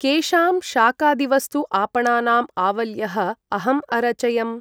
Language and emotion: Sanskrit, neutral